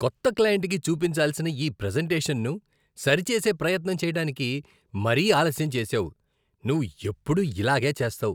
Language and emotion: Telugu, disgusted